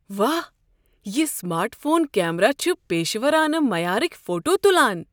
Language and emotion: Kashmiri, surprised